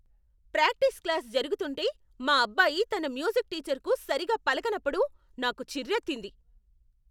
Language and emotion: Telugu, angry